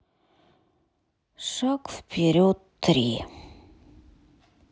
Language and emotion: Russian, sad